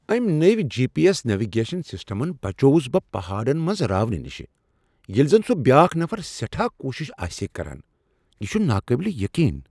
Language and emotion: Kashmiri, surprised